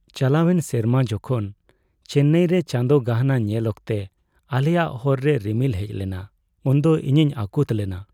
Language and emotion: Santali, sad